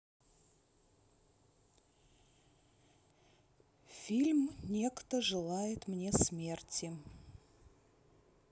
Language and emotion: Russian, neutral